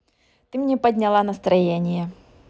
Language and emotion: Russian, positive